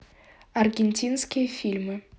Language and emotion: Russian, neutral